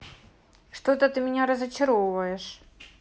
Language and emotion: Russian, neutral